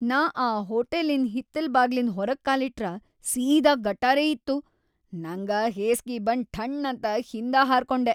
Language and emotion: Kannada, disgusted